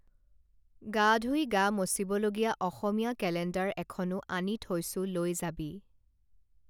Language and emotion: Assamese, neutral